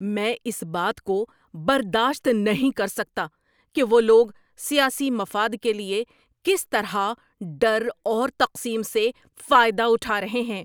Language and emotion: Urdu, angry